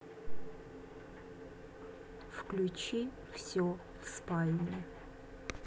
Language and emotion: Russian, neutral